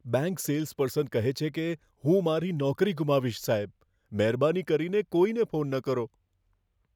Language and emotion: Gujarati, fearful